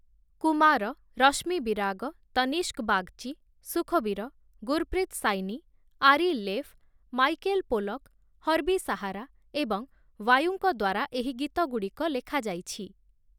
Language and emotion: Odia, neutral